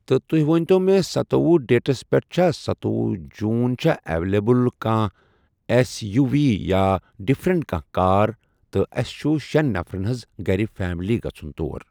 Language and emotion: Kashmiri, neutral